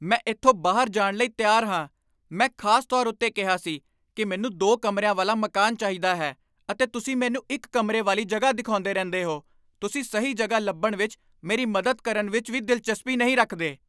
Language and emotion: Punjabi, angry